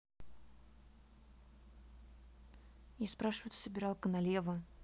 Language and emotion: Russian, neutral